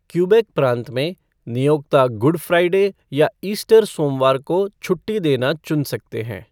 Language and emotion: Hindi, neutral